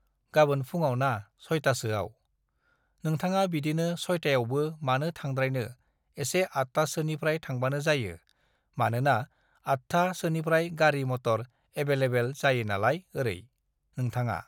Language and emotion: Bodo, neutral